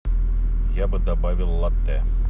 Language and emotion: Russian, neutral